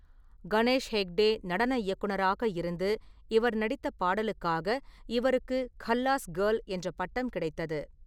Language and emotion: Tamil, neutral